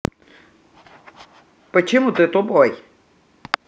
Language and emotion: Russian, angry